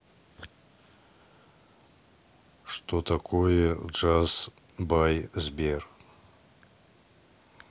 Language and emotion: Russian, neutral